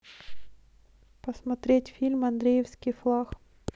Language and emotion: Russian, neutral